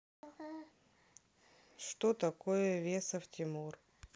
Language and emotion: Russian, neutral